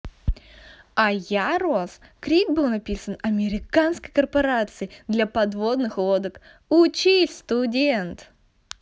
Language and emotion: Russian, positive